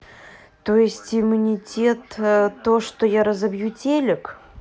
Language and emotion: Russian, neutral